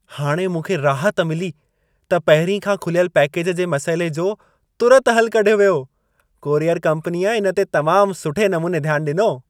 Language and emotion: Sindhi, happy